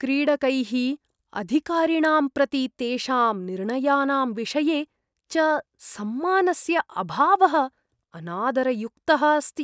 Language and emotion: Sanskrit, disgusted